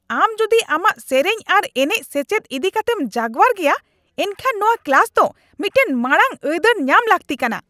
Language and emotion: Santali, angry